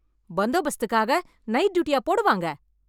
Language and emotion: Tamil, angry